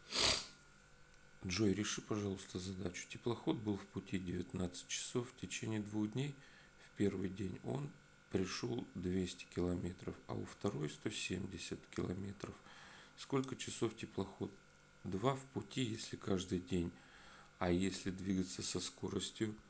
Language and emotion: Russian, neutral